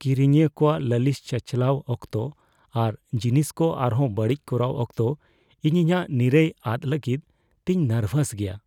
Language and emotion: Santali, fearful